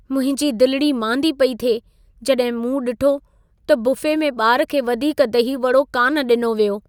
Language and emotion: Sindhi, sad